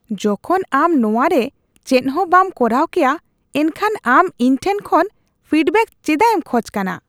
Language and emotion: Santali, disgusted